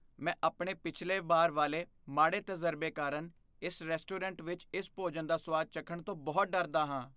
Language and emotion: Punjabi, fearful